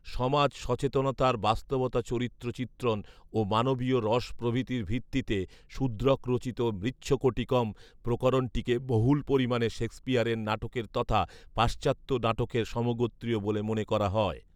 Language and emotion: Bengali, neutral